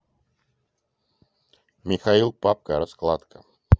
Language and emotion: Russian, neutral